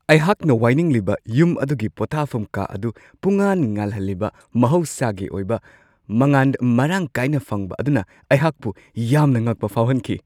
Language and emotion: Manipuri, surprised